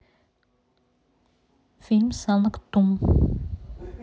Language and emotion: Russian, neutral